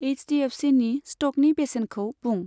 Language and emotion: Bodo, neutral